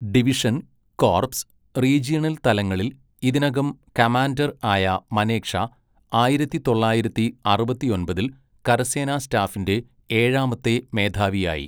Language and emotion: Malayalam, neutral